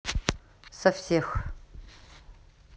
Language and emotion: Russian, neutral